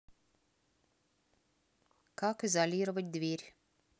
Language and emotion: Russian, neutral